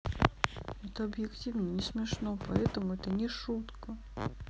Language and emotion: Russian, sad